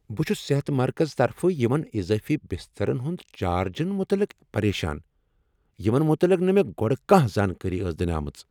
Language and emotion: Kashmiri, angry